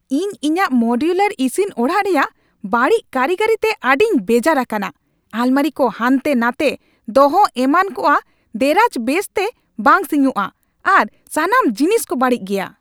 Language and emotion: Santali, angry